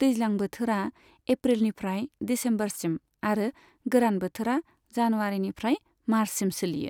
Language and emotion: Bodo, neutral